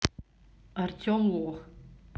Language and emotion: Russian, neutral